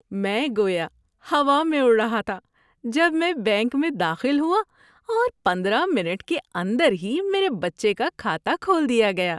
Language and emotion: Urdu, happy